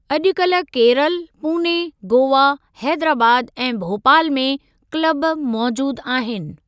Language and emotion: Sindhi, neutral